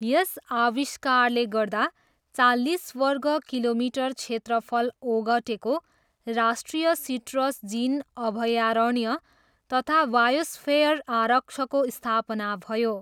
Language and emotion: Nepali, neutral